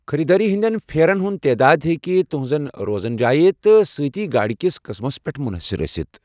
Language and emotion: Kashmiri, neutral